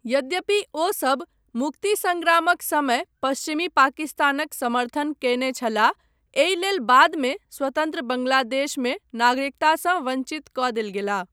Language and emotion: Maithili, neutral